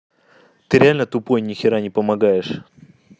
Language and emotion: Russian, angry